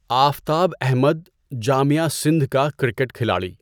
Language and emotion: Urdu, neutral